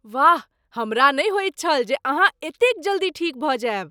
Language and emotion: Maithili, surprised